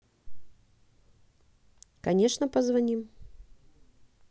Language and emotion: Russian, neutral